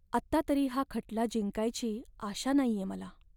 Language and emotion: Marathi, sad